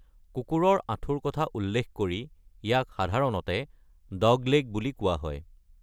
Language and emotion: Assamese, neutral